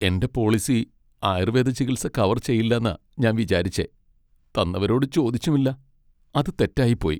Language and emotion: Malayalam, sad